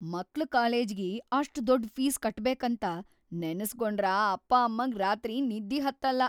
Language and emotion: Kannada, fearful